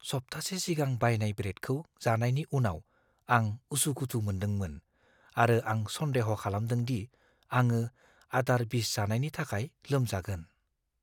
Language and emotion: Bodo, fearful